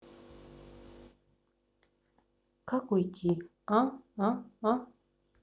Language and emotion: Russian, sad